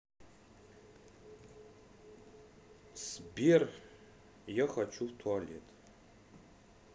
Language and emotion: Russian, neutral